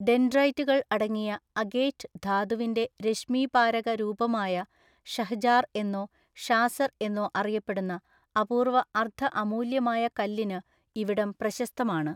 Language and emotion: Malayalam, neutral